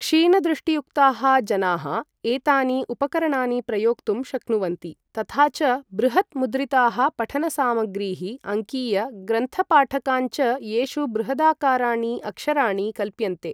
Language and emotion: Sanskrit, neutral